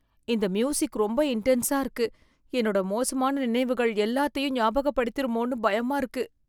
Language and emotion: Tamil, fearful